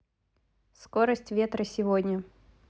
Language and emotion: Russian, neutral